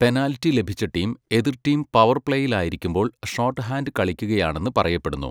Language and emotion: Malayalam, neutral